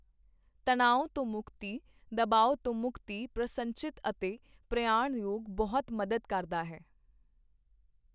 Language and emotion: Punjabi, neutral